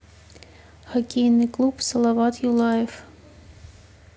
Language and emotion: Russian, neutral